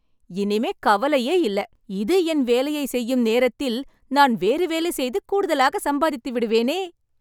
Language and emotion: Tamil, happy